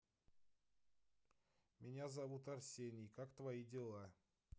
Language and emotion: Russian, neutral